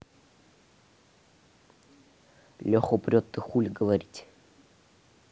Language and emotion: Russian, neutral